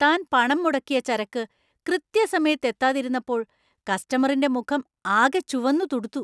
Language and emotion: Malayalam, angry